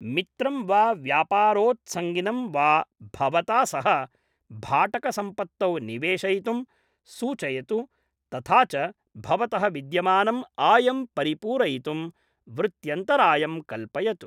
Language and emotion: Sanskrit, neutral